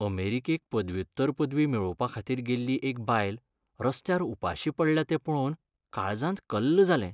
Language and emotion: Goan Konkani, sad